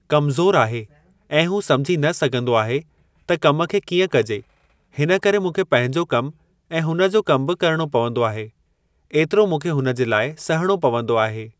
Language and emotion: Sindhi, neutral